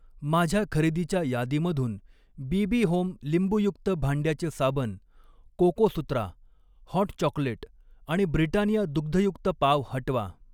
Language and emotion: Marathi, neutral